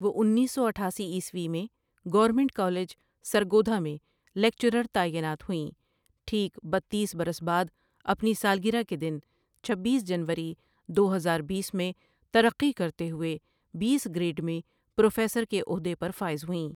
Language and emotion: Urdu, neutral